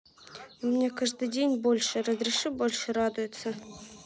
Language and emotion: Russian, neutral